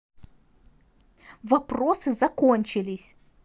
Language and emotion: Russian, angry